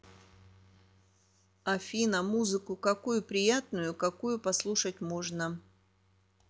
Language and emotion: Russian, neutral